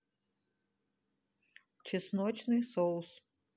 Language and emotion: Russian, neutral